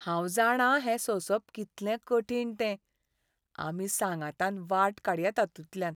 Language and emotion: Goan Konkani, sad